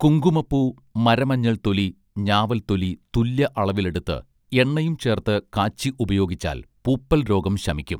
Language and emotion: Malayalam, neutral